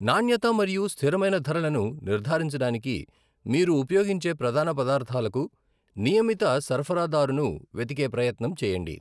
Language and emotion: Telugu, neutral